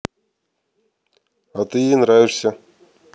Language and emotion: Russian, neutral